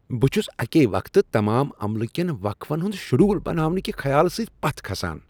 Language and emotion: Kashmiri, disgusted